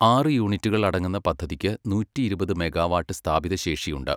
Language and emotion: Malayalam, neutral